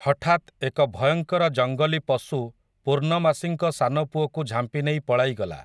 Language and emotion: Odia, neutral